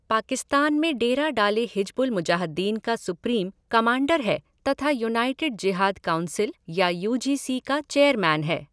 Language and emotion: Hindi, neutral